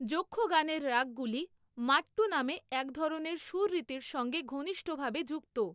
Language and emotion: Bengali, neutral